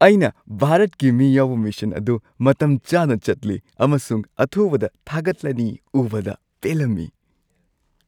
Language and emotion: Manipuri, happy